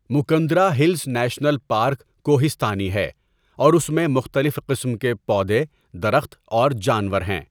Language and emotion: Urdu, neutral